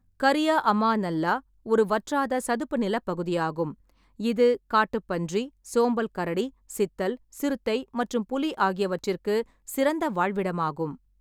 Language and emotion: Tamil, neutral